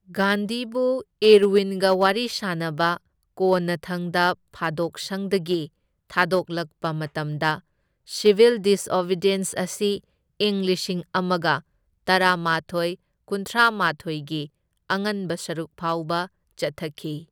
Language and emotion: Manipuri, neutral